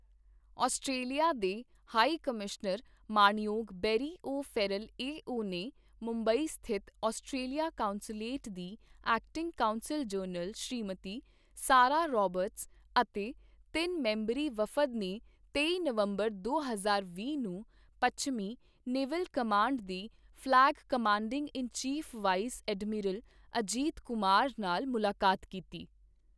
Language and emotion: Punjabi, neutral